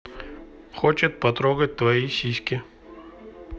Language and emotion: Russian, neutral